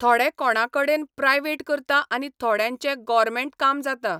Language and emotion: Goan Konkani, neutral